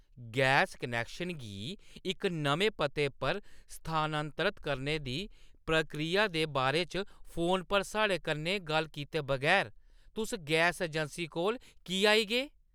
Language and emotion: Dogri, angry